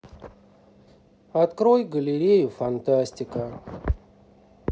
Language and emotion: Russian, sad